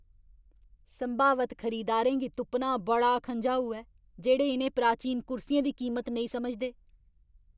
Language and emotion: Dogri, angry